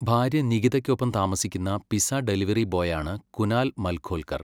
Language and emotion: Malayalam, neutral